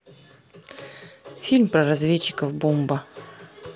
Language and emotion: Russian, neutral